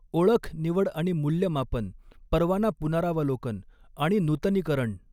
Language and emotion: Marathi, neutral